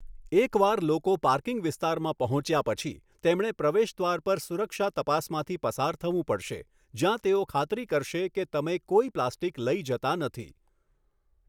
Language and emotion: Gujarati, neutral